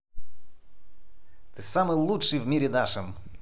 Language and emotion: Russian, positive